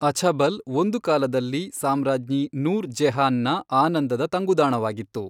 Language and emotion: Kannada, neutral